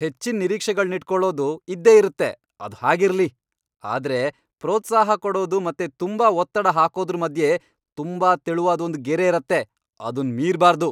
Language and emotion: Kannada, angry